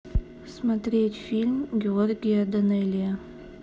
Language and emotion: Russian, neutral